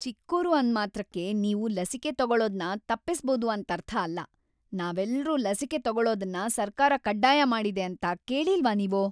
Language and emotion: Kannada, angry